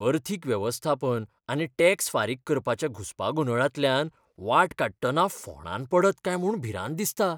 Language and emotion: Goan Konkani, fearful